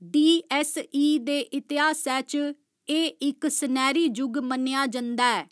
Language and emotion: Dogri, neutral